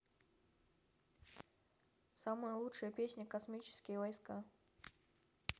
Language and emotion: Russian, neutral